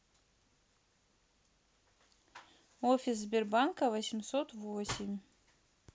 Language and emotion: Russian, neutral